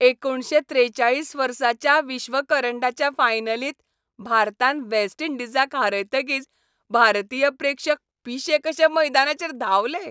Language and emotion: Goan Konkani, happy